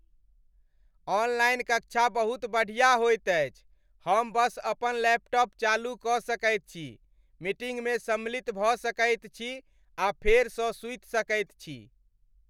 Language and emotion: Maithili, happy